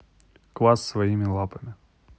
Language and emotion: Russian, neutral